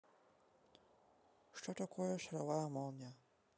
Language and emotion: Russian, neutral